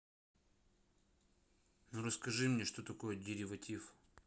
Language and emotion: Russian, neutral